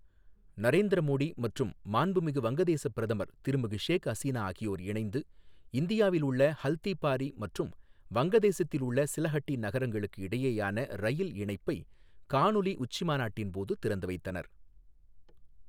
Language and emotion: Tamil, neutral